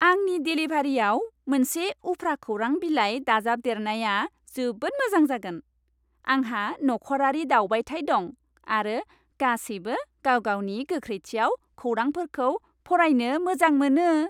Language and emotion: Bodo, happy